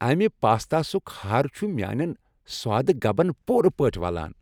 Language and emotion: Kashmiri, happy